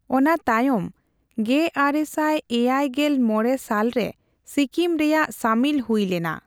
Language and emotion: Santali, neutral